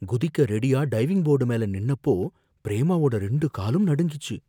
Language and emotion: Tamil, fearful